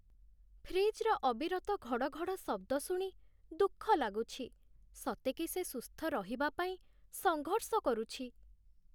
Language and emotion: Odia, sad